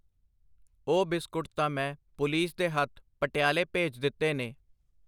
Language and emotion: Punjabi, neutral